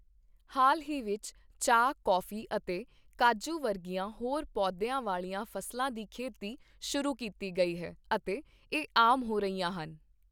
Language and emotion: Punjabi, neutral